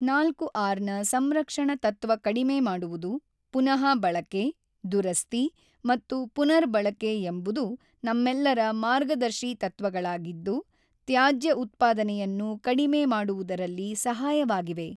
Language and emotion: Kannada, neutral